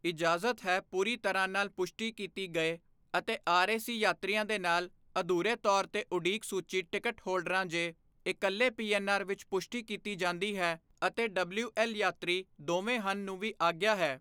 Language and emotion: Punjabi, neutral